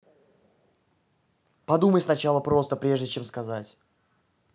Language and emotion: Russian, angry